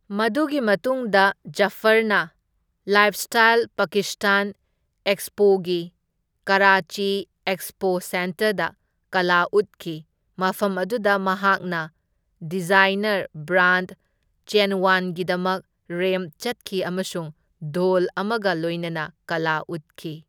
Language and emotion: Manipuri, neutral